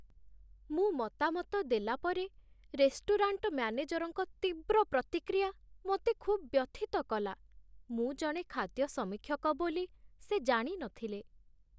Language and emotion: Odia, sad